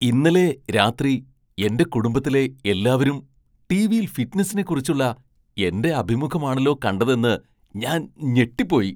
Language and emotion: Malayalam, surprised